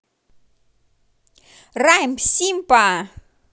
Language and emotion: Russian, positive